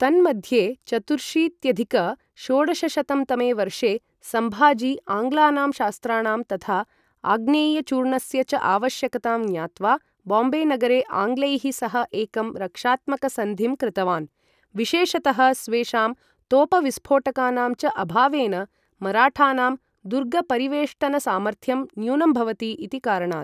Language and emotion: Sanskrit, neutral